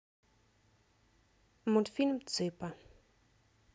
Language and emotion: Russian, neutral